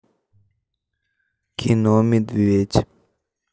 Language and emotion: Russian, neutral